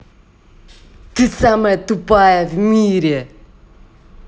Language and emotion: Russian, angry